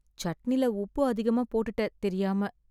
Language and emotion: Tamil, sad